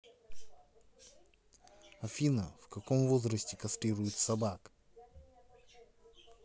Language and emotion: Russian, neutral